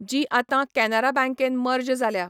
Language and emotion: Goan Konkani, neutral